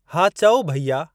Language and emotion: Sindhi, neutral